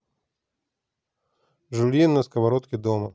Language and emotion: Russian, neutral